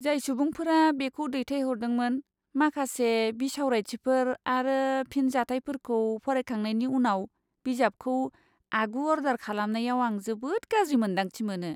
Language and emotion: Bodo, disgusted